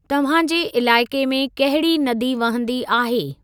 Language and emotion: Sindhi, neutral